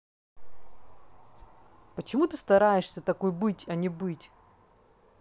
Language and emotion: Russian, angry